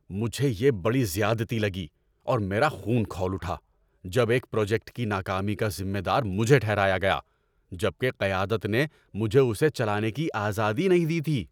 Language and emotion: Urdu, angry